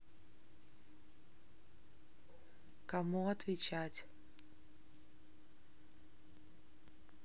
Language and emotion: Russian, neutral